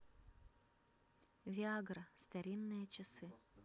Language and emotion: Russian, neutral